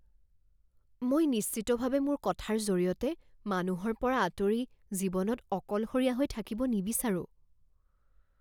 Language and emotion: Assamese, fearful